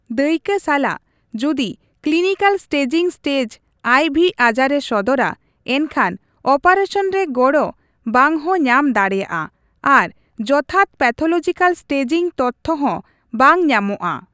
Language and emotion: Santali, neutral